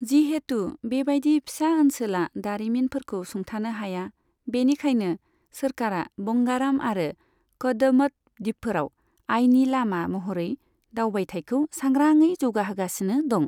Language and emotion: Bodo, neutral